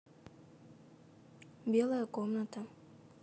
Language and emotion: Russian, neutral